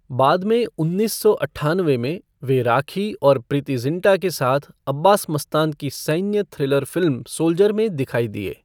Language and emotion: Hindi, neutral